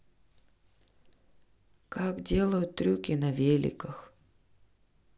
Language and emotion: Russian, sad